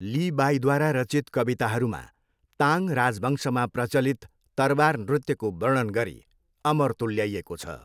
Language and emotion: Nepali, neutral